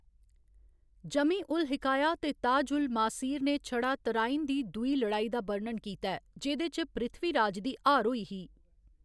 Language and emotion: Dogri, neutral